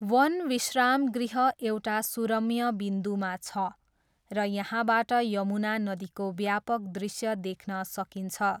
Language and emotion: Nepali, neutral